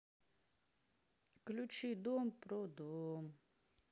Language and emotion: Russian, sad